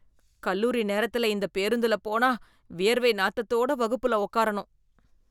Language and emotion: Tamil, disgusted